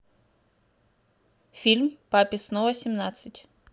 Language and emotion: Russian, neutral